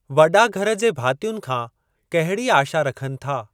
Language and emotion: Sindhi, neutral